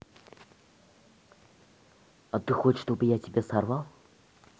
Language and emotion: Russian, neutral